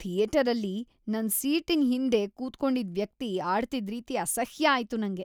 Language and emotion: Kannada, disgusted